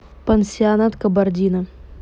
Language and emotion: Russian, neutral